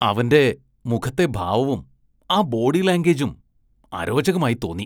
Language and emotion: Malayalam, disgusted